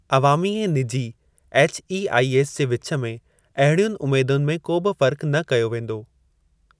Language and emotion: Sindhi, neutral